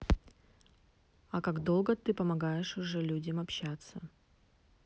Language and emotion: Russian, neutral